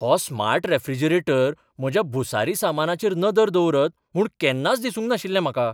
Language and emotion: Goan Konkani, surprised